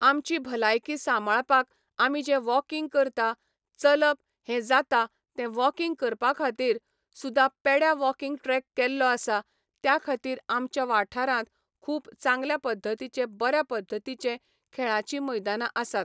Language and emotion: Goan Konkani, neutral